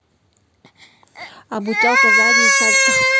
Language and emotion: Russian, neutral